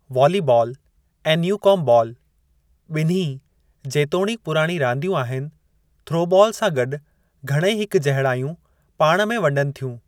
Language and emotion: Sindhi, neutral